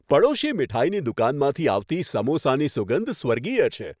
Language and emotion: Gujarati, happy